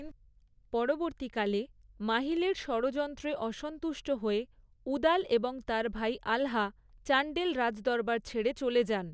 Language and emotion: Bengali, neutral